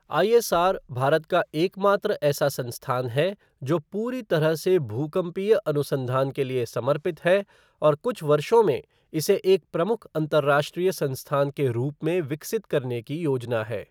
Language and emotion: Hindi, neutral